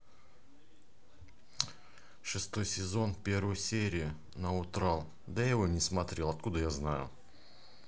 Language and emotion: Russian, neutral